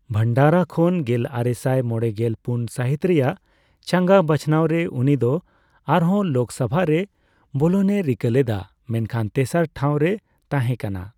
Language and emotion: Santali, neutral